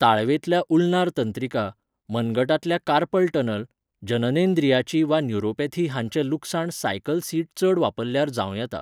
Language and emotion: Goan Konkani, neutral